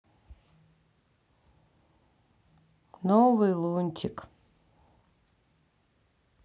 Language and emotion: Russian, sad